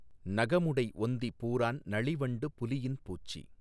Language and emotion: Tamil, neutral